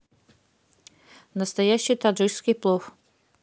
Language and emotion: Russian, neutral